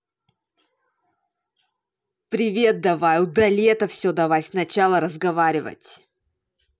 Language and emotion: Russian, angry